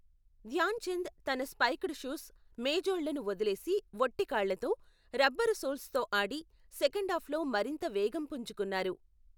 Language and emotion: Telugu, neutral